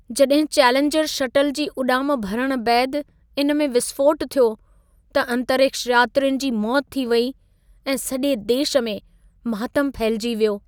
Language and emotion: Sindhi, sad